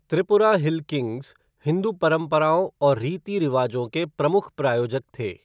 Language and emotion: Hindi, neutral